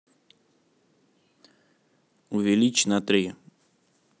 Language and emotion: Russian, neutral